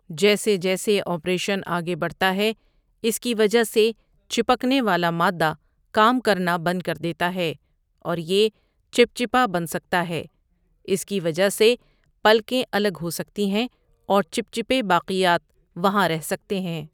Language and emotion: Urdu, neutral